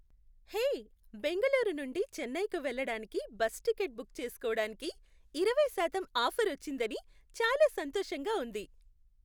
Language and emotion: Telugu, happy